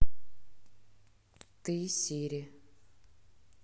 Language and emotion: Russian, neutral